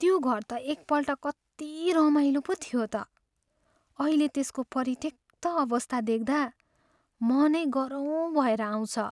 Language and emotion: Nepali, sad